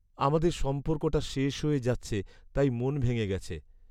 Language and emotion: Bengali, sad